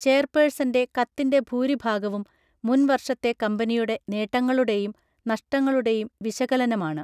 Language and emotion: Malayalam, neutral